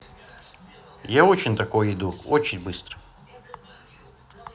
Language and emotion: Russian, positive